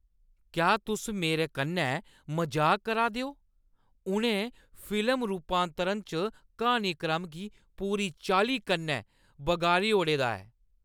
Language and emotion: Dogri, angry